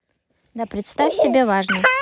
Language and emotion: Russian, neutral